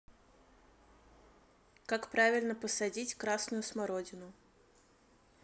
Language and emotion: Russian, neutral